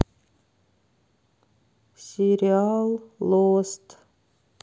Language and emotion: Russian, sad